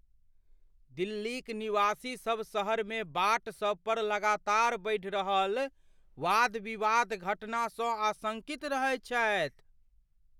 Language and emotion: Maithili, fearful